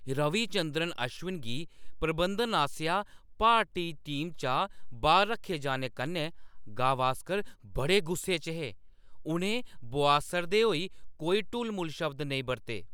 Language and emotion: Dogri, angry